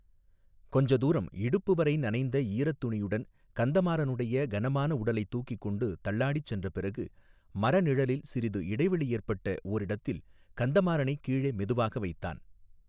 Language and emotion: Tamil, neutral